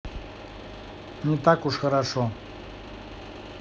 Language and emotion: Russian, neutral